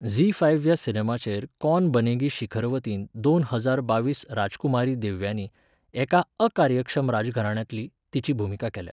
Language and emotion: Goan Konkani, neutral